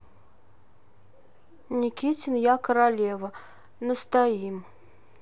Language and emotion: Russian, neutral